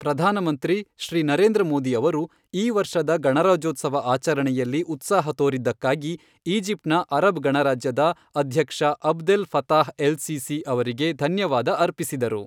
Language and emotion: Kannada, neutral